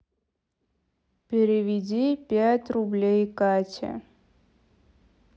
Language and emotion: Russian, sad